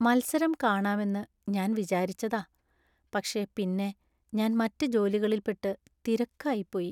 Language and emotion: Malayalam, sad